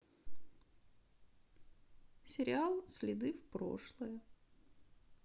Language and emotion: Russian, sad